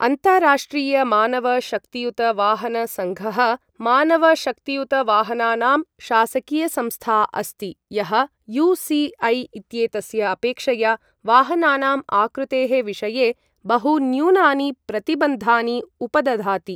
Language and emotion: Sanskrit, neutral